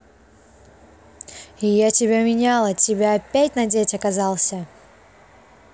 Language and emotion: Russian, angry